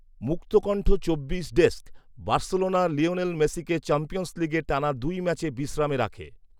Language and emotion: Bengali, neutral